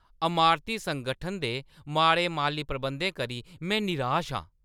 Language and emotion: Dogri, angry